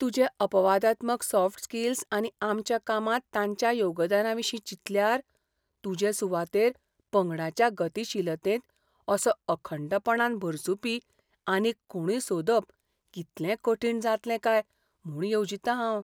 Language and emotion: Goan Konkani, fearful